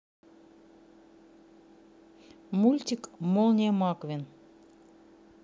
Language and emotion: Russian, neutral